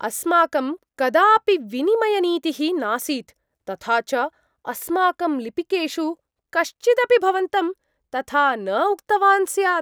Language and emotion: Sanskrit, surprised